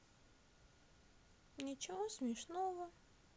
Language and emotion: Russian, neutral